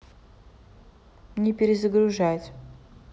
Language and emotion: Russian, neutral